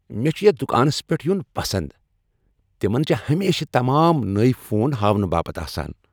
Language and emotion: Kashmiri, happy